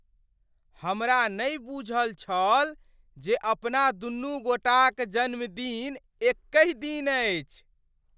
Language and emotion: Maithili, surprised